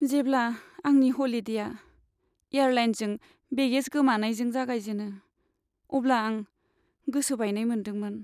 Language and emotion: Bodo, sad